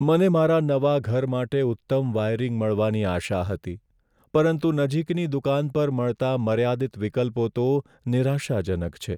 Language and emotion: Gujarati, sad